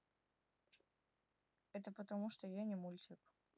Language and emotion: Russian, neutral